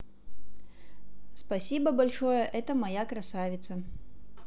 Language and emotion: Russian, neutral